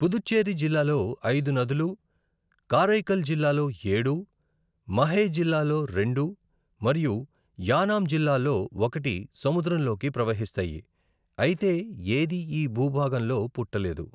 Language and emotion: Telugu, neutral